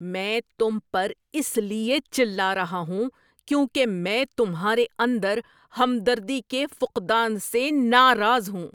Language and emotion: Urdu, angry